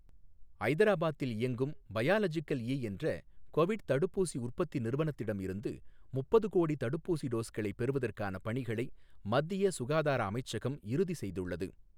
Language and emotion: Tamil, neutral